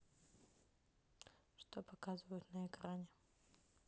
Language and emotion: Russian, neutral